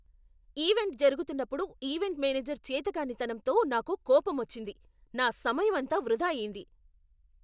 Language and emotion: Telugu, angry